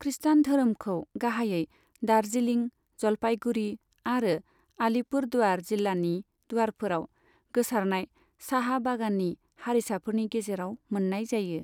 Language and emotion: Bodo, neutral